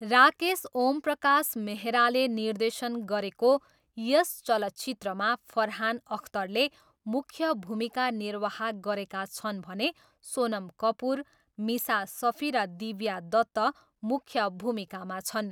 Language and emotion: Nepali, neutral